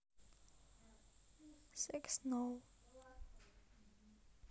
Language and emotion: Russian, neutral